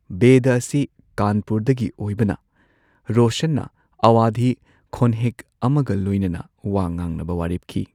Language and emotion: Manipuri, neutral